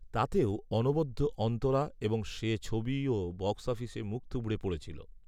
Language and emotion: Bengali, neutral